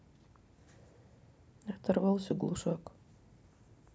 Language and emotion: Russian, sad